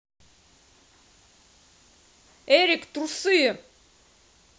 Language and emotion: Russian, angry